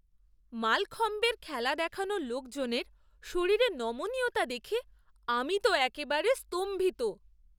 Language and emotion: Bengali, surprised